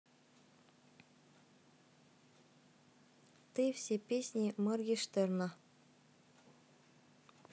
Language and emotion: Russian, neutral